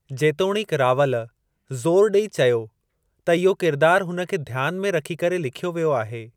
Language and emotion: Sindhi, neutral